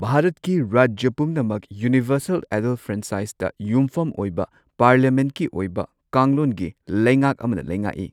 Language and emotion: Manipuri, neutral